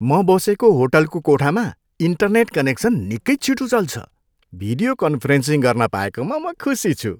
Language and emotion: Nepali, happy